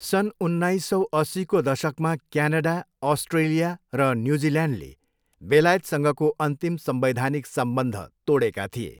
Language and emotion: Nepali, neutral